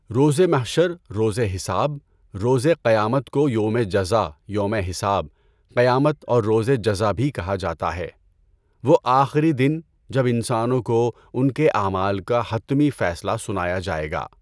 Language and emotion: Urdu, neutral